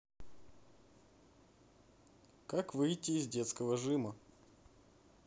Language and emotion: Russian, neutral